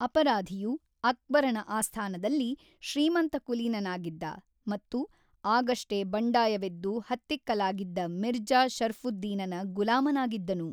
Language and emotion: Kannada, neutral